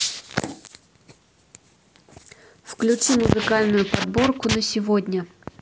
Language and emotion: Russian, neutral